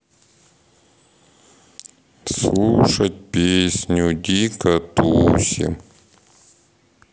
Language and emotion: Russian, sad